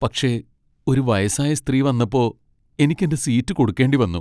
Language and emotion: Malayalam, sad